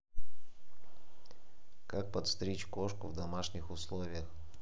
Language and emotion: Russian, neutral